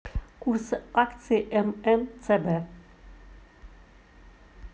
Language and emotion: Russian, neutral